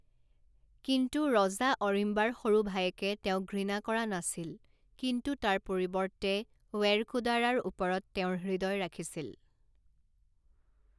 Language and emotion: Assamese, neutral